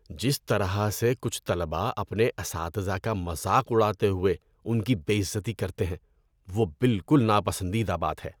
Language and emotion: Urdu, disgusted